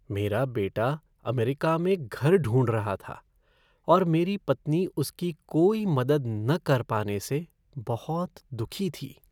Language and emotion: Hindi, sad